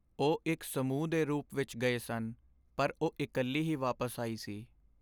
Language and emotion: Punjabi, sad